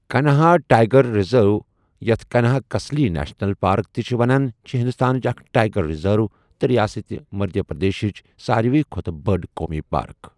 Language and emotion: Kashmiri, neutral